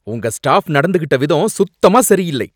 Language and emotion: Tamil, angry